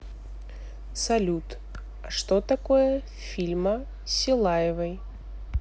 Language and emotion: Russian, neutral